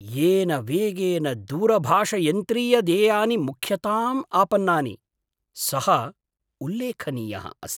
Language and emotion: Sanskrit, surprised